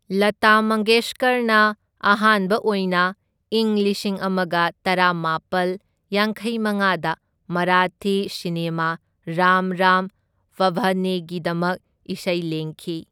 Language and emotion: Manipuri, neutral